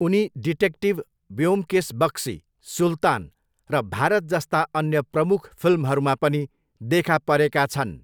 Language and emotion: Nepali, neutral